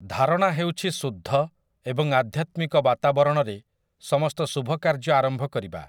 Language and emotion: Odia, neutral